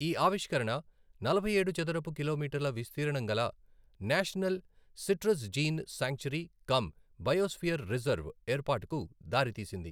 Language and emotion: Telugu, neutral